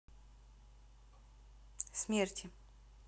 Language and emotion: Russian, neutral